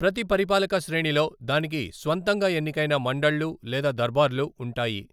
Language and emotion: Telugu, neutral